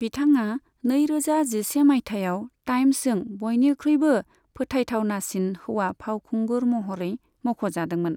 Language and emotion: Bodo, neutral